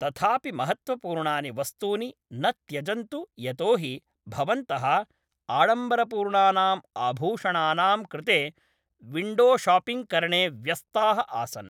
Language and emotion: Sanskrit, neutral